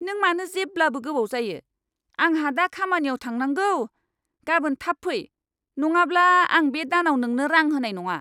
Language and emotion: Bodo, angry